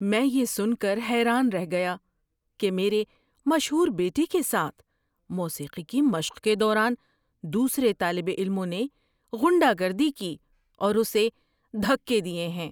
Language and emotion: Urdu, surprised